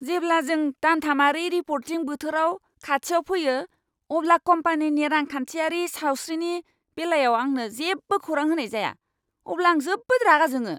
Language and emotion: Bodo, angry